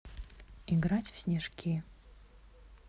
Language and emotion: Russian, neutral